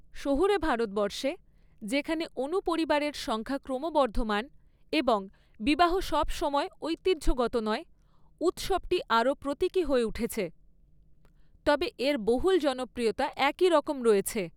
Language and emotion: Bengali, neutral